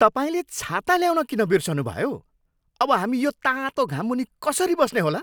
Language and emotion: Nepali, angry